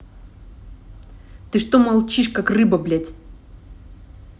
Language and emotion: Russian, angry